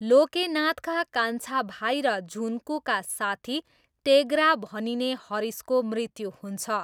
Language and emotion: Nepali, neutral